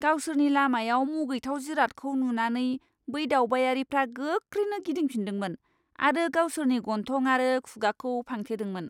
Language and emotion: Bodo, disgusted